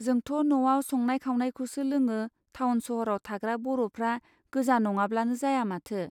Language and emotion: Bodo, neutral